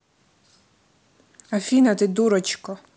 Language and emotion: Russian, neutral